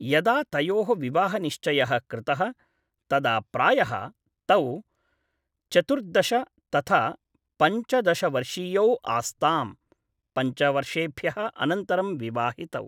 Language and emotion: Sanskrit, neutral